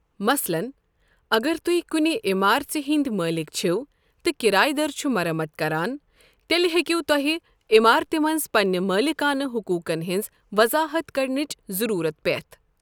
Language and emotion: Kashmiri, neutral